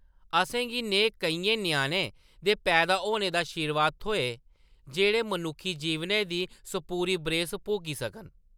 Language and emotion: Dogri, neutral